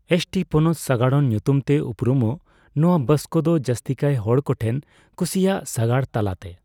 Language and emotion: Santali, neutral